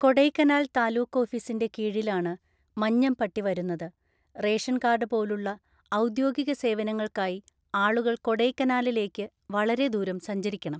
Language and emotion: Malayalam, neutral